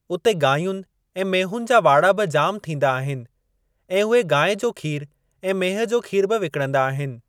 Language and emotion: Sindhi, neutral